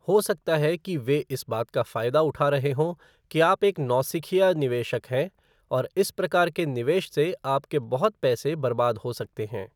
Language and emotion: Hindi, neutral